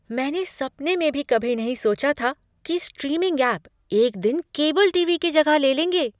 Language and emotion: Hindi, surprised